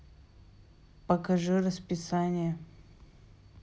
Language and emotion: Russian, neutral